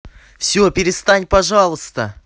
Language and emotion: Russian, angry